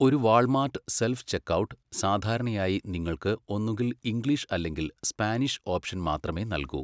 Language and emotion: Malayalam, neutral